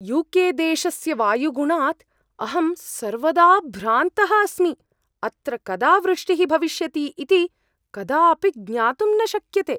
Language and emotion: Sanskrit, surprised